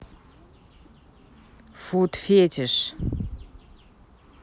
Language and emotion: Russian, neutral